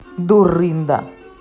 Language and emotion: Russian, angry